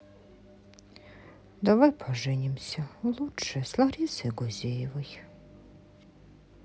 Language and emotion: Russian, sad